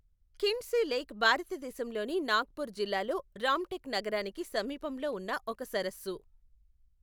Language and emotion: Telugu, neutral